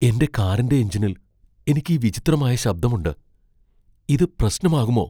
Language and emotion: Malayalam, fearful